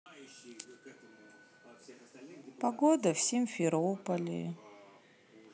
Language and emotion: Russian, sad